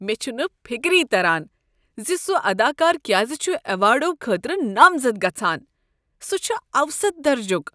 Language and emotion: Kashmiri, disgusted